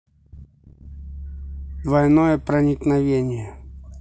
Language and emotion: Russian, neutral